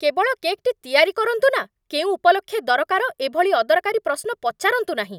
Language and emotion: Odia, angry